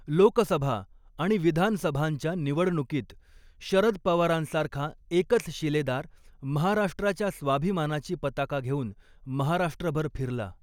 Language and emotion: Marathi, neutral